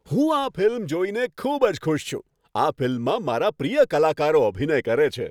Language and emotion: Gujarati, happy